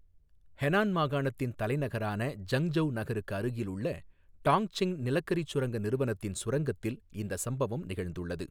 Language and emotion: Tamil, neutral